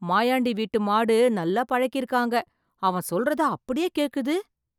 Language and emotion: Tamil, surprised